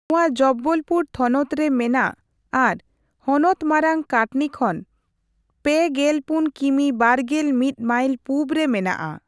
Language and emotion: Santali, neutral